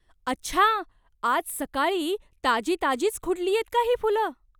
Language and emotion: Marathi, surprised